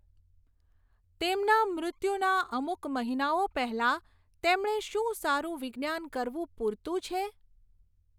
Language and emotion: Gujarati, neutral